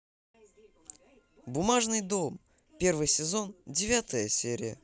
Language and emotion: Russian, positive